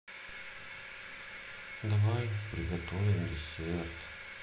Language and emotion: Russian, sad